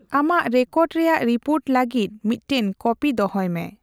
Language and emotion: Santali, neutral